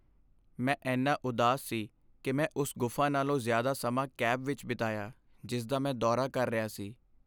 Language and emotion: Punjabi, sad